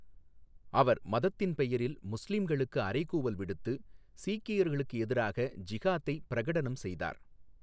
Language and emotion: Tamil, neutral